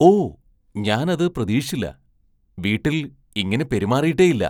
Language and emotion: Malayalam, surprised